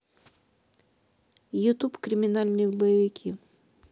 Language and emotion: Russian, neutral